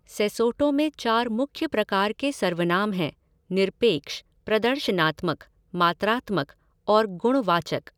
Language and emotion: Hindi, neutral